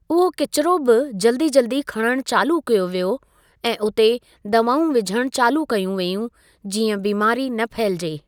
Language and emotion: Sindhi, neutral